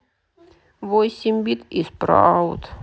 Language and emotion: Russian, sad